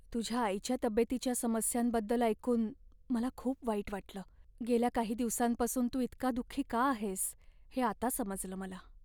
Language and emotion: Marathi, sad